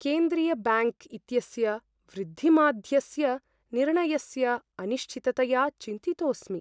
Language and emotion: Sanskrit, fearful